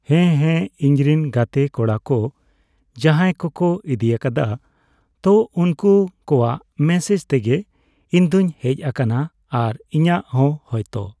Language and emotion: Santali, neutral